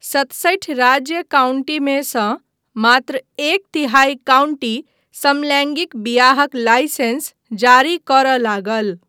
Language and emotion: Maithili, neutral